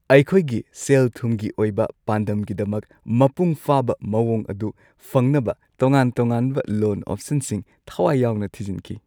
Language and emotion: Manipuri, happy